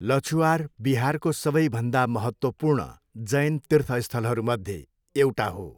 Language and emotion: Nepali, neutral